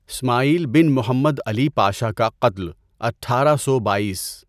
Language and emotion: Urdu, neutral